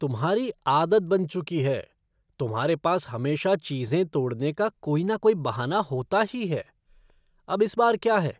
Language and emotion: Hindi, disgusted